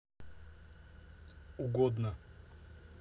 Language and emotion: Russian, neutral